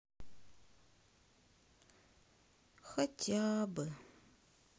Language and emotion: Russian, sad